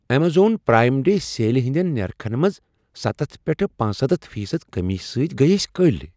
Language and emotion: Kashmiri, surprised